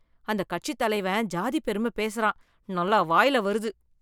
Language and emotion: Tamil, disgusted